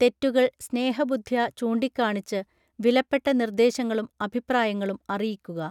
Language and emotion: Malayalam, neutral